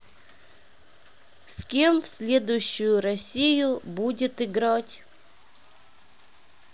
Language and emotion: Russian, neutral